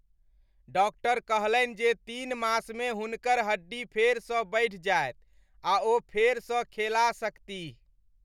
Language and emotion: Maithili, happy